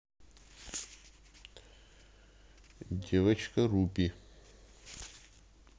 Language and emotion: Russian, neutral